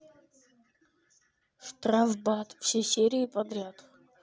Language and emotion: Russian, neutral